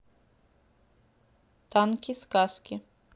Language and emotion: Russian, neutral